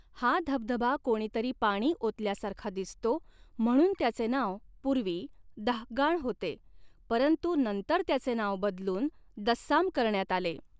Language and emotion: Marathi, neutral